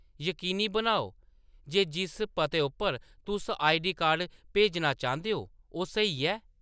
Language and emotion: Dogri, neutral